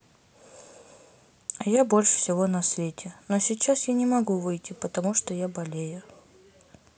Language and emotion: Russian, sad